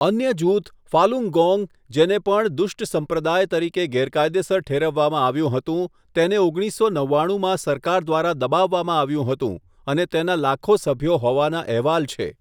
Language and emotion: Gujarati, neutral